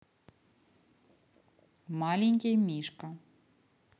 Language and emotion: Russian, neutral